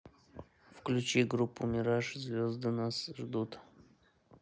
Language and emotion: Russian, neutral